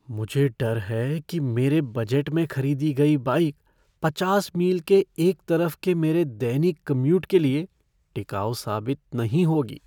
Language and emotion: Hindi, fearful